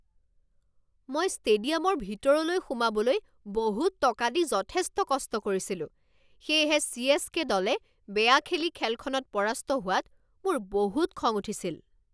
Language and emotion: Assamese, angry